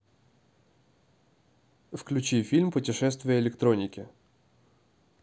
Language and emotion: Russian, neutral